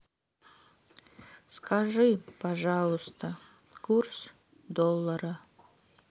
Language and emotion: Russian, sad